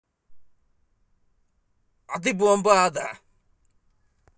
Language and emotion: Russian, angry